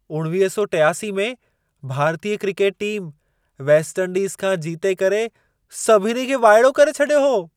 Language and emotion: Sindhi, surprised